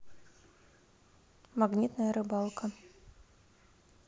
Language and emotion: Russian, neutral